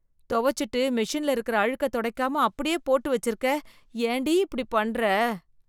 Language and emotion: Tamil, disgusted